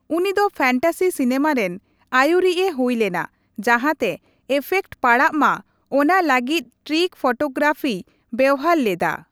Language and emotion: Santali, neutral